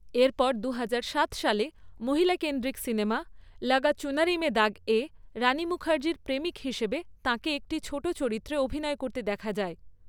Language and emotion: Bengali, neutral